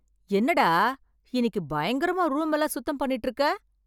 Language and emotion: Tamil, surprised